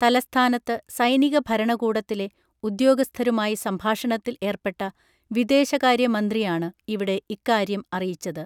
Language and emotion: Malayalam, neutral